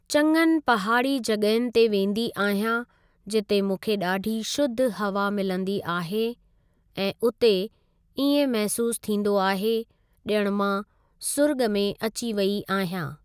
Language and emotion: Sindhi, neutral